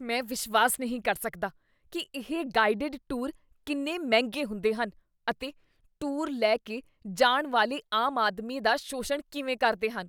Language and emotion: Punjabi, disgusted